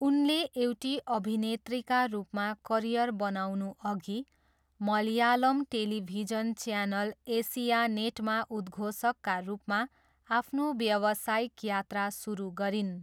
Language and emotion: Nepali, neutral